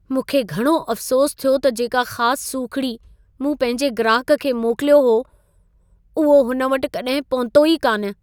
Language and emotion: Sindhi, sad